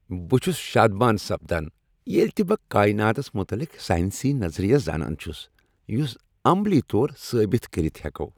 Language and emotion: Kashmiri, happy